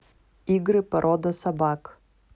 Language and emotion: Russian, neutral